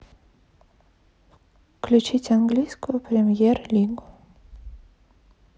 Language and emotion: Russian, neutral